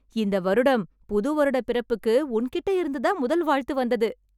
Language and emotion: Tamil, happy